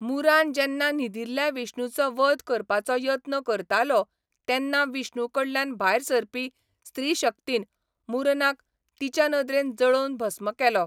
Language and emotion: Goan Konkani, neutral